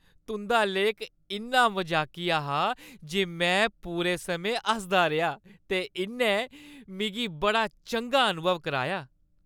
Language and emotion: Dogri, happy